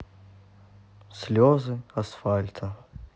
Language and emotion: Russian, sad